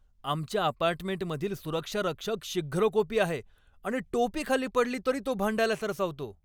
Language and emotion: Marathi, angry